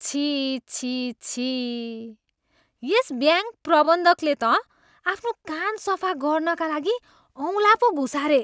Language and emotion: Nepali, disgusted